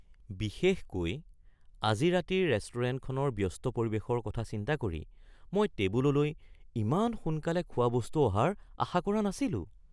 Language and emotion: Assamese, surprised